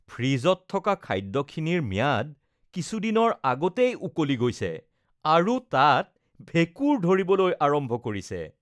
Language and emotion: Assamese, disgusted